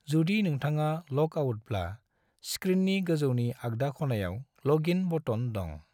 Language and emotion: Bodo, neutral